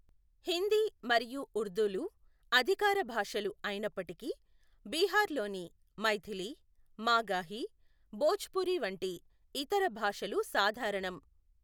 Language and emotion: Telugu, neutral